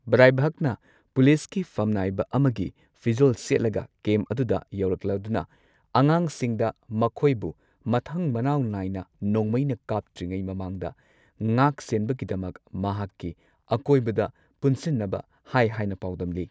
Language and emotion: Manipuri, neutral